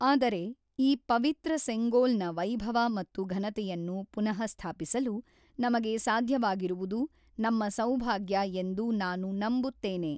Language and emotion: Kannada, neutral